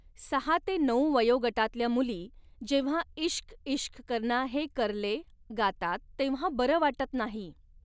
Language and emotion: Marathi, neutral